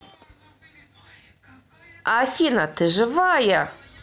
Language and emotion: Russian, positive